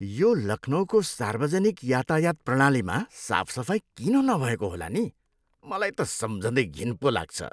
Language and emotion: Nepali, disgusted